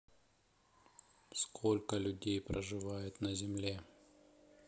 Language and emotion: Russian, neutral